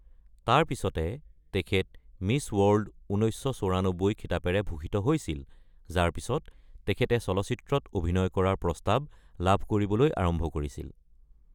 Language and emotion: Assamese, neutral